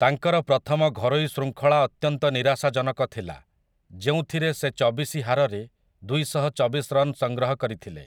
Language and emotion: Odia, neutral